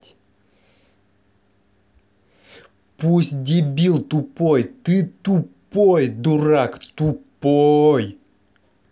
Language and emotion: Russian, angry